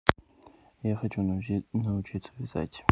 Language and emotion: Russian, neutral